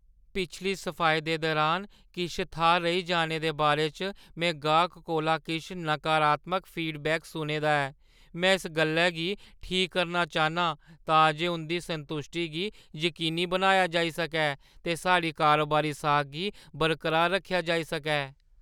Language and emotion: Dogri, fearful